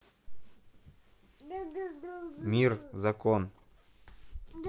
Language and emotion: Russian, neutral